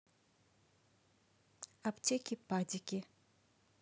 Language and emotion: Russian, neutral